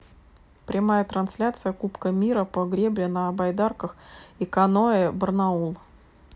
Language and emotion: Russian, neutral